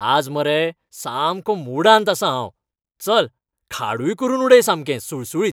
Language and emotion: Goan Konkani, happy